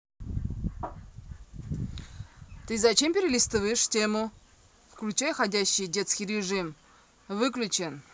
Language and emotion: Russian, angry